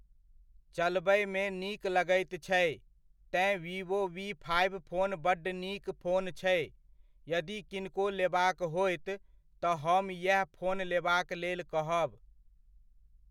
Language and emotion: Maithili, neutral